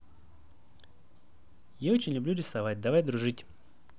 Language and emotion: Russian, neutral